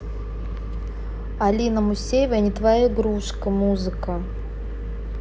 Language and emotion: Russian, neutral